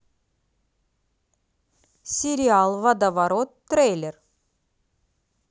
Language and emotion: Russian, positive